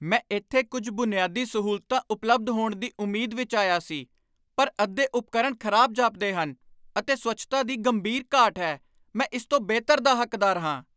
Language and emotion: Punjabi, angry